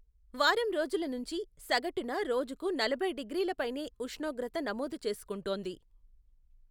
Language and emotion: Telugu, neutral